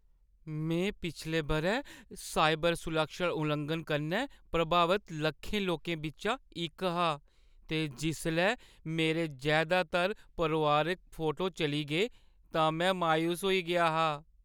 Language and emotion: Dogri, sad